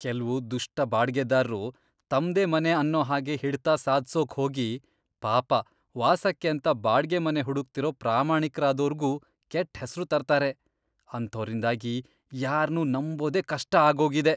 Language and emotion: Kannada, disgusted